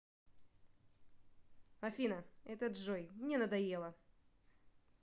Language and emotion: Russian, angry